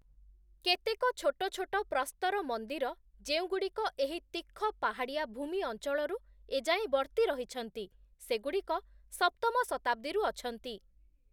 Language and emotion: Odia, neutral